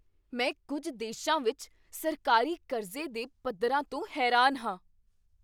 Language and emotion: Punjabi, surprised